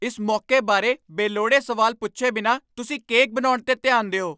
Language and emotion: Punjabi, angry